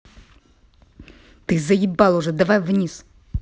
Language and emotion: Russian, angry